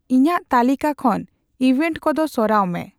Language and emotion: Santali, neutral